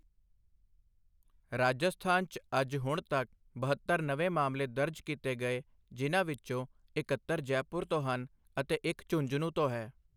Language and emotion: Punjabi, neutral